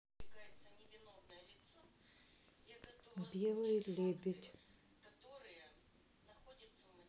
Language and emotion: Russian, neutral